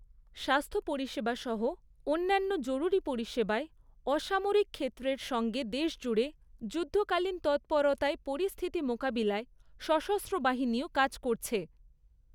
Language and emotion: Bengali, neutral